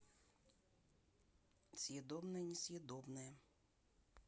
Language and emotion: Russian, neutral